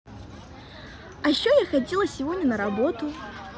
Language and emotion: Russian, positive